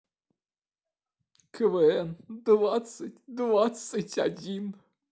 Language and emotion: Russian, sad